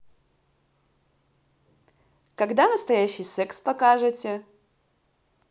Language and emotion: Russian, positive